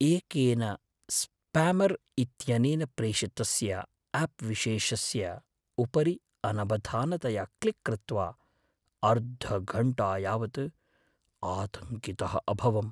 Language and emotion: Sanskrit, fearful